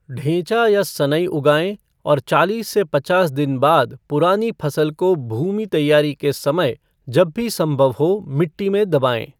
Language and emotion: Hindi, neutral